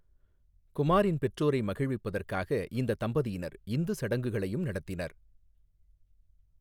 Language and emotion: Tamil, neutral